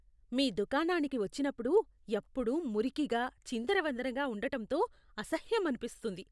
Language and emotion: Telugu, disgusted